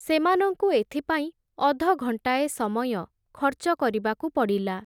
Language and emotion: Odia, neutral